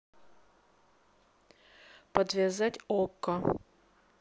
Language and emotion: Russian, neutral